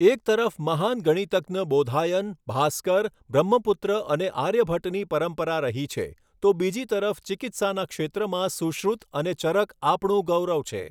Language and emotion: Gujarati, neutral